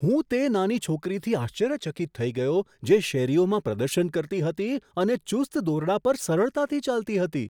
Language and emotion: Gujarati, surprised